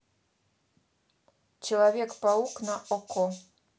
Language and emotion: Russian, neutral